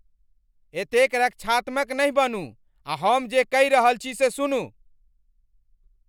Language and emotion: Maithili, angry